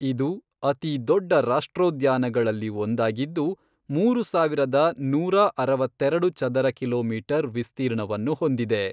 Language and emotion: Kannada, neutral